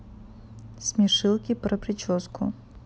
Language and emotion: Russian, neutral